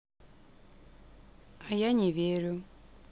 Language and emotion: Russian, neutral